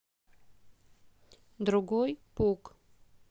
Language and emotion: Russian, neutral